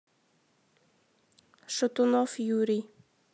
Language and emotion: Russian, neutral